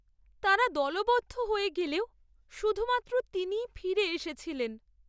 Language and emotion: Bengali, sad